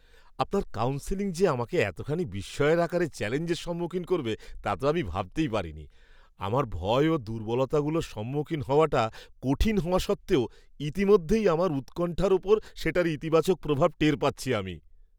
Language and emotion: Bengali, surprised